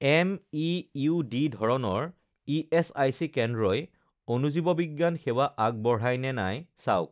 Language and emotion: Assamese, neutral